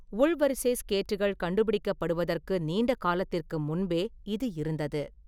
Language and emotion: Tamil, neutral